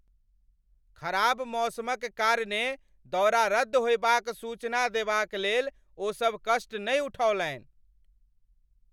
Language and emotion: Maithili, angry